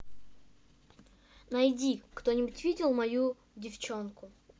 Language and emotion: Russian, neutral